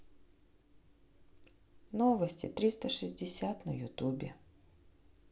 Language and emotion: Russian, neutral